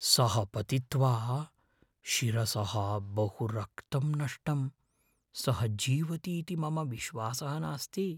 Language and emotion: Sanskrit, fearful